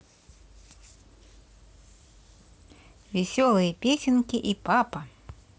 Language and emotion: Russian, positive